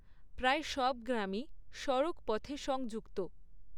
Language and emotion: Bengali, neutral